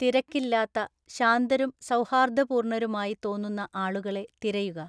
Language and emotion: Malayalam, neutral